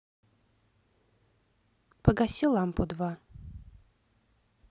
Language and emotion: Russian, neutral